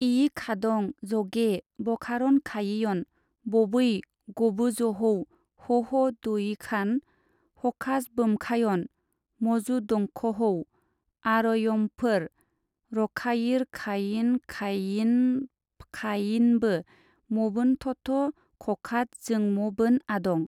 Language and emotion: Bodo, neutral